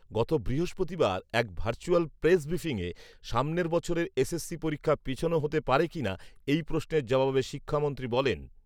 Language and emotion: Bengali, neutral